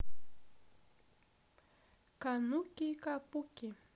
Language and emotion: Russian, positive